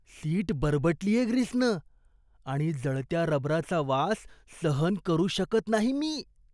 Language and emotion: Marathi, disgusted